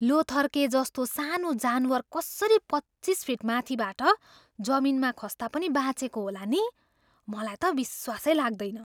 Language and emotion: Nepali, surprised